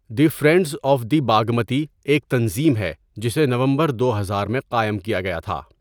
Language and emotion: Urdu, neutral